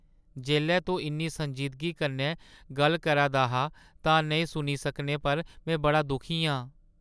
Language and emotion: Dogri, sad